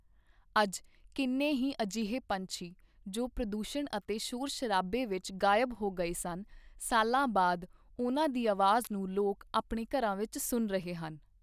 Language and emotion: Punjabi, neutral